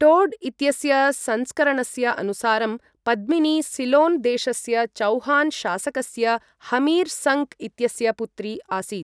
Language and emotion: Sanskrit, neutral